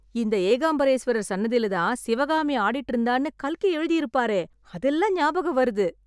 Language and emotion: Tamil, happy